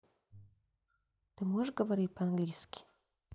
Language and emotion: Russian, neutral